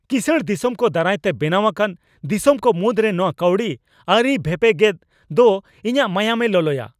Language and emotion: Santali, angry